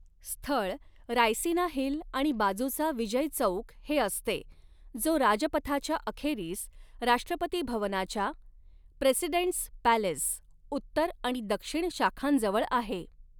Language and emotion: Marathi, neutral